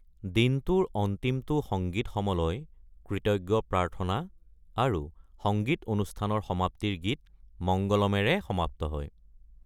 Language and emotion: Assamese, neutral